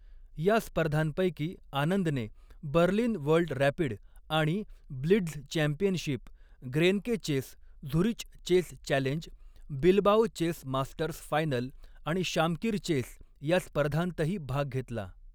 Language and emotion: Marathi, neutral